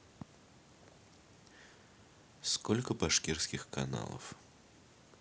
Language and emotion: Russian, neutral